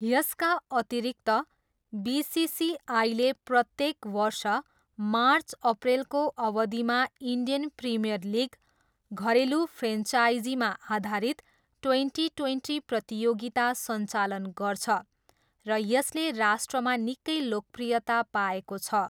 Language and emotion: Nepali, neutral